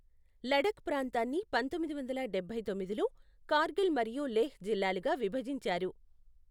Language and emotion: Telugu, neutral